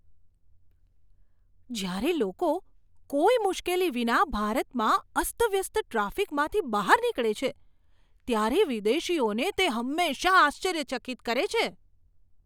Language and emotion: Gujarati, surprised